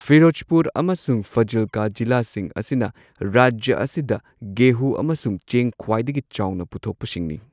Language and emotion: Manipuri, neutral